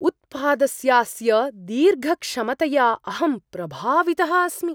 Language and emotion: Sanskrit, surprised